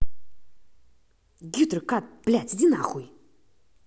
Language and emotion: Russian, angry